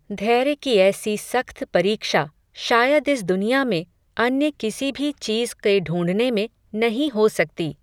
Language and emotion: Hindi, neutral